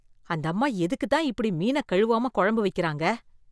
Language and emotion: Tamil, disgusted